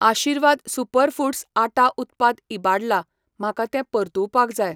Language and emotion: Goan Konkani, neutral